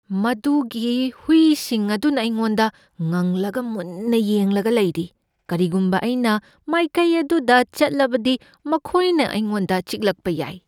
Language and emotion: Manipuri, fearful